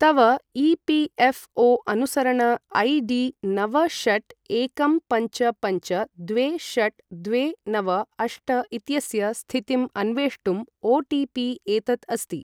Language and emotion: Sanskrit, neutral